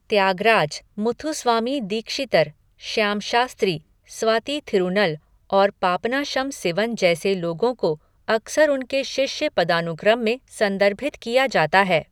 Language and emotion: Hindi, neutral